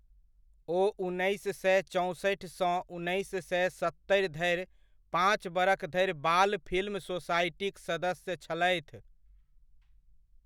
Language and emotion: Maithili, neutral